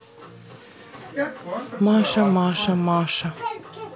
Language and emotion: Russian, neutral